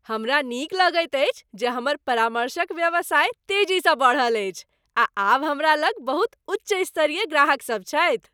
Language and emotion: Maithili, happy